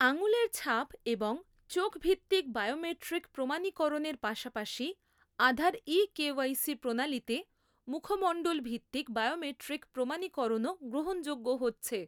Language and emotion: Bengali, neutral